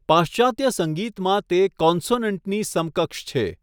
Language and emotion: Gujarati, neutral